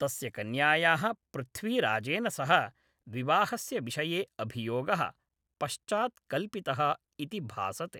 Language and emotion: Sanskrit, neutral